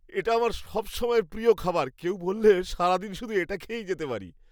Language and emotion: Bengali, happy